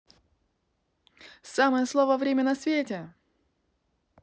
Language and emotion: Russian, positive